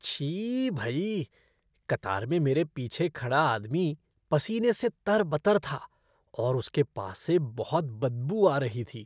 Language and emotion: Hindi, disgusted